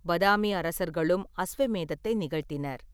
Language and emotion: Tamil, neutral